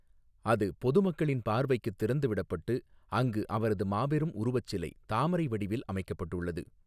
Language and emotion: Tamil, neutral